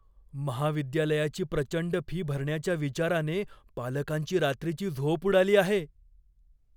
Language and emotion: Marathi, fearful